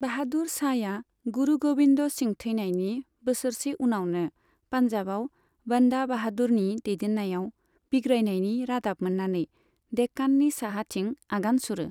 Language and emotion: Bodo, neutral